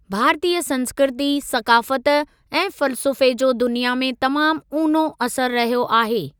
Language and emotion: Sindhi, neutral